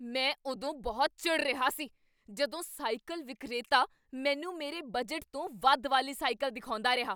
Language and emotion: Punjabi, angry